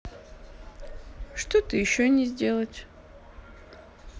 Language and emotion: Russian, neutral